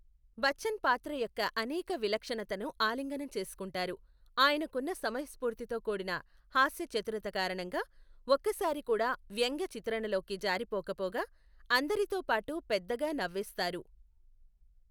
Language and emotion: Telugu, neutral